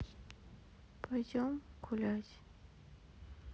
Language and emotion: Russian, sad